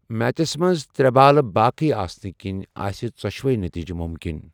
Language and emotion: Kashmiri, neutral